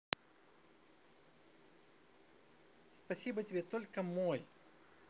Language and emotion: Russian, positive